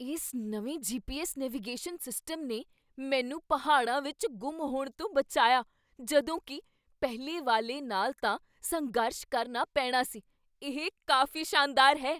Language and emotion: Punjabi, surprised